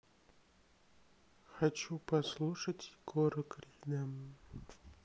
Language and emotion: Russian, sad